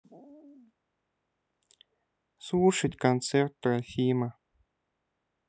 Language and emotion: Russian, sad